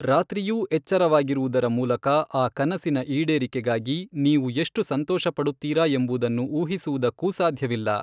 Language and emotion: Kannada, neutral